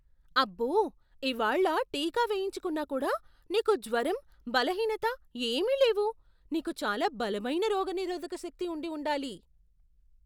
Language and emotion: Telugu, surprised